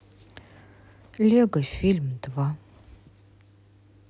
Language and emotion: Russian, sad